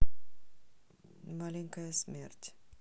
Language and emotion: Russian, neutral